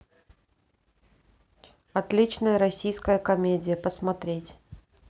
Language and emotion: Russian, neutral